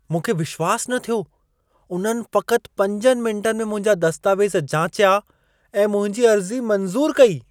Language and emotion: Sindhi, surprised